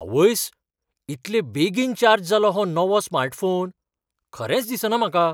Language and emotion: Goan Konkani, surprised